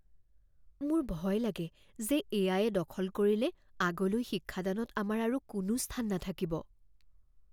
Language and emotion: Assamese, fearful